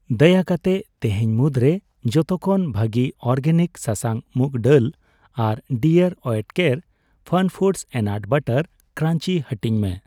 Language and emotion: Santali, neutral